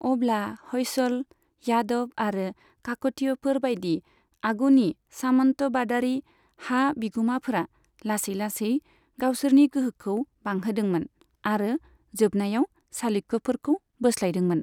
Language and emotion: Bodo, neutral